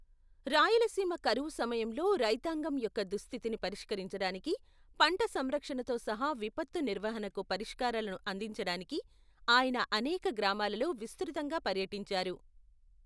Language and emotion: Telugu, neutral